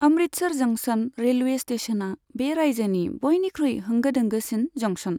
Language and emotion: Bodo, neutral